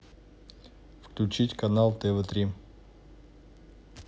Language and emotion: Russian, neutral